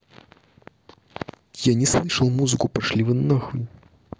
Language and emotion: Russian, angry